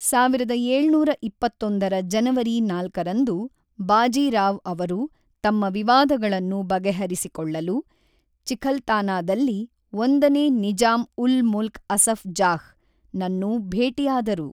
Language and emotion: Kannada, neutral